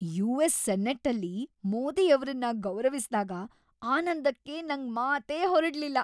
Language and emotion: Kannada, happy